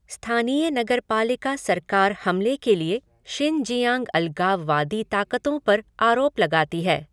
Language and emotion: Hindi, neutral